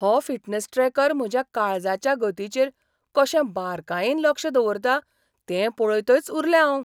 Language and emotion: Goan Konkani, surprised